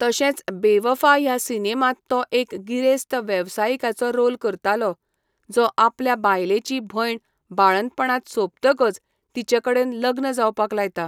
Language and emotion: Goan Konkani, neutral